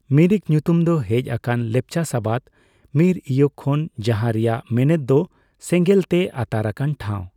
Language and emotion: Santali, neutral